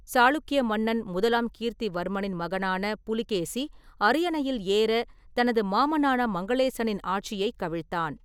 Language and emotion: Tamil, neutral